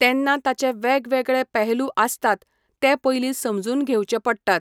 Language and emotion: Goan Konkani, neutral